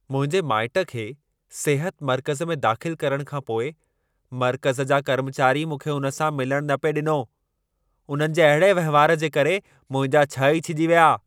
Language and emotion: Sindhi, angry